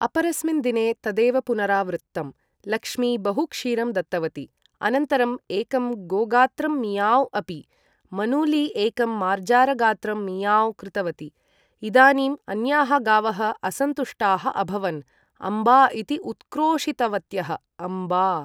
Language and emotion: Sanskrit, neutral